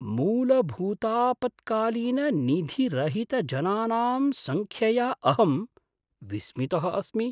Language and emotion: Sanskrit, surprised